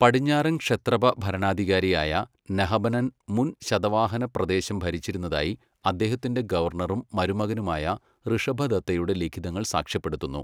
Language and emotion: Malayalam, neutral